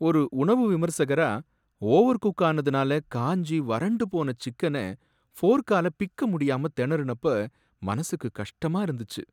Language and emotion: Tamil, sad